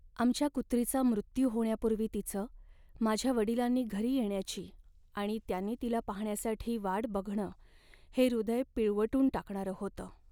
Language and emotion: Marathi, sad